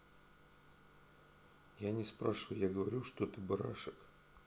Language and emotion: Russian, sad